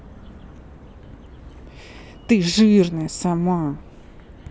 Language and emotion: Russian, angry